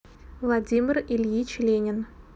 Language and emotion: Russian, neutral